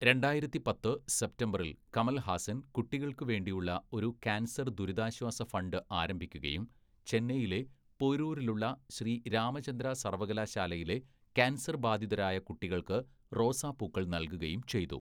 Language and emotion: Malayalam, neutral